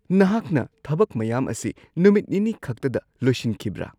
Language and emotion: Manipuri, surprised